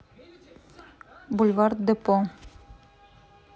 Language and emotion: Russian, neutral